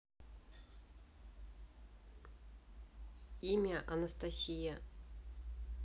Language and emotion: Russian, neutral